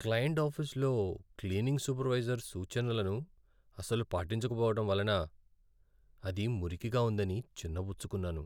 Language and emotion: Telugu, sad